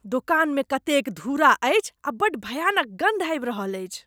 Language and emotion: Maithili, disgusted